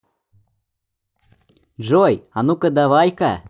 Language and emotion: Russian, positive